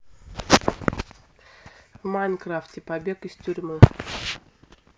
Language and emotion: Russian, neutral